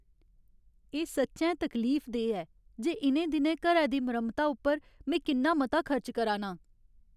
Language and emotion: Dogri, sad